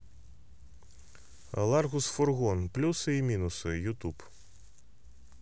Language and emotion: Russian, neutral